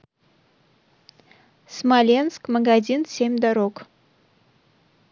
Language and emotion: Russian, neutral